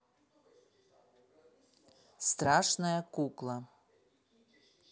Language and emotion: Russian, neutral